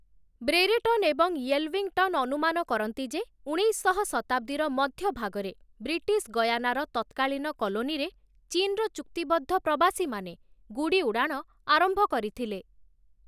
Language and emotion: Odia, neutral